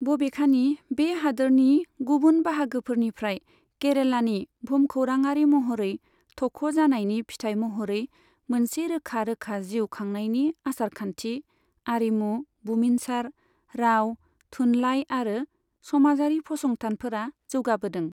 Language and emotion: Bodo, neutral